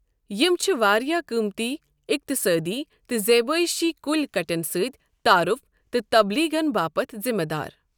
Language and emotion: Kashmiri, neutral